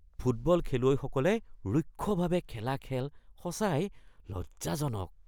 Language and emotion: Assamese, disgusted